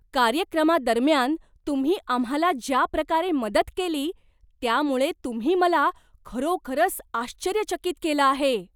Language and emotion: Marathi, surprised